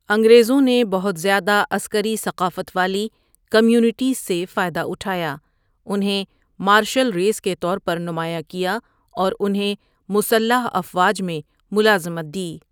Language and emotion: Urdu, neutral